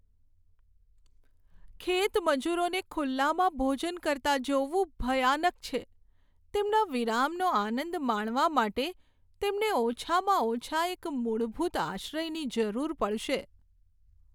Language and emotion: Gujarati, sad